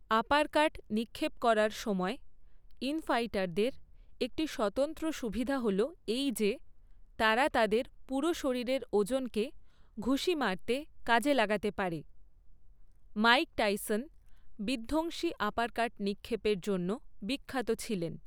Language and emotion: Bengali, neutral